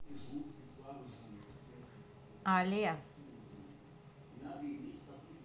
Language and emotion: Russian, neutral